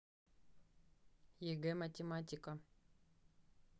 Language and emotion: Russian, neutral